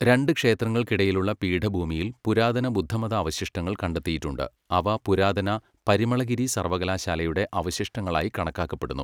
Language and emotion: Malayalam, neutral